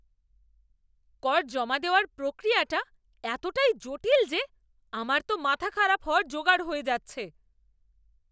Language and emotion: Bengali, angry